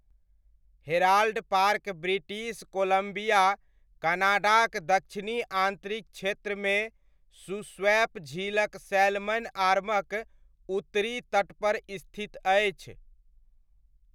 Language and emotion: Maithili, neutral